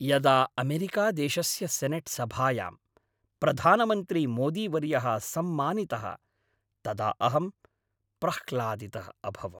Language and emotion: Sanskrit, happy